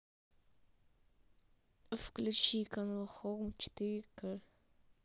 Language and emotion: Russian, neutral